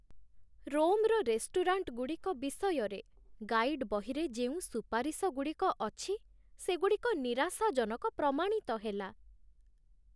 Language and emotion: Odia, sad